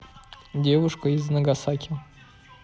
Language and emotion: Russian, neutral